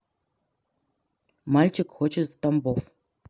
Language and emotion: Russian, neutral